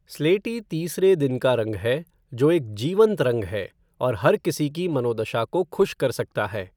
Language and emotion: Hindi, neutral